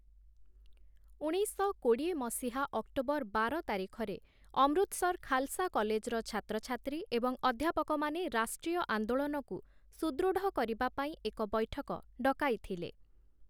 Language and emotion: Odia, neutral